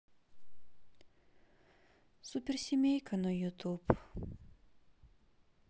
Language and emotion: Russian, sad